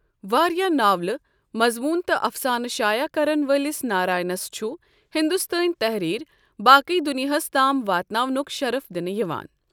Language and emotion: Kashmiri, neutral